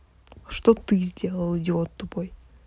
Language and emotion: Russian, angry